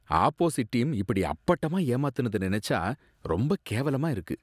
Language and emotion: Tamil, disgusted